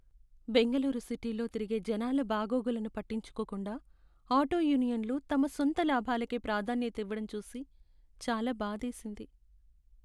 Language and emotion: Telugu, sad